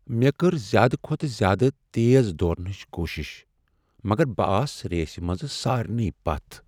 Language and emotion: Kashmiri, sad